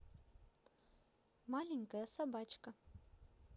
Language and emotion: Russian, positive